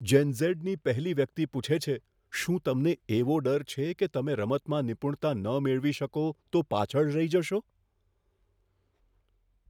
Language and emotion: Gujarati, fearful